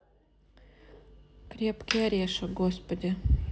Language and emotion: Russian, neutral